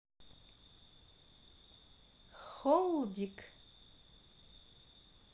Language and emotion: Russian, positive